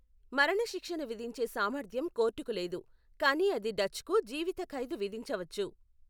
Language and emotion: Telugu, neutral